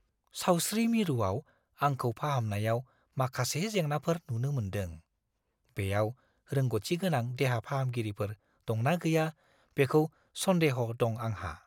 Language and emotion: Bodo, fearful